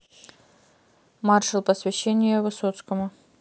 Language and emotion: Russian, neutral